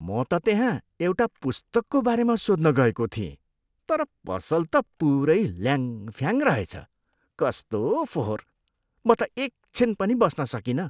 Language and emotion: Nepali, disgusted